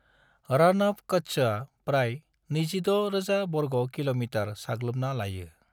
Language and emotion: Bodo, neutral